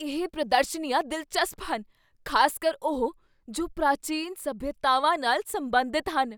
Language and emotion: Punjabi, surprised